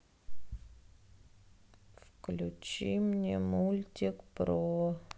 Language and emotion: Russian, sad